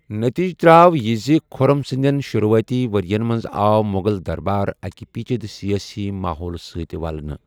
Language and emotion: Kashmiri, neutral